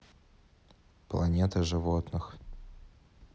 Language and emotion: Russian, neutral